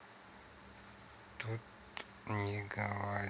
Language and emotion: Russian, neutral